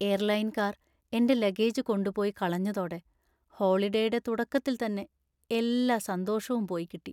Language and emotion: Malayalam, sad